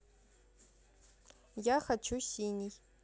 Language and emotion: Russian, neutral